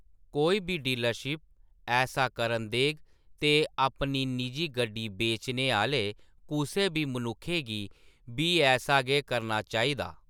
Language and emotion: Dogri, neutral